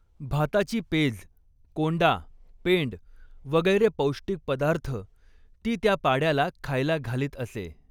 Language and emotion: Marathi, neutral